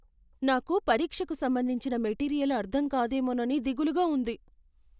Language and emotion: Telugu, fearful